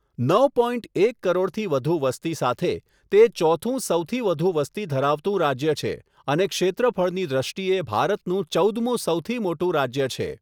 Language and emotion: Gujarati, neutral